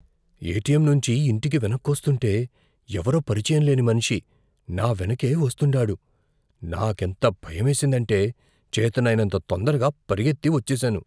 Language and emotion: Telugu, fearful